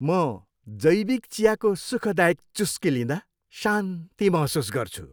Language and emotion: Nepali, happy